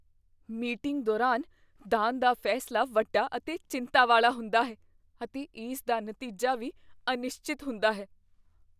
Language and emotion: Punjabi, fearful